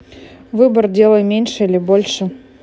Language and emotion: Russian, neutral